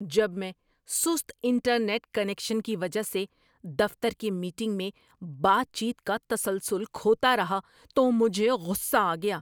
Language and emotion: Urdu, angry